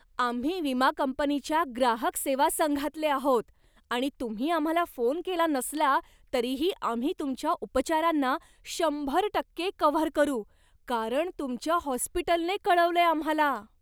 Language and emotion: Marathi, surprised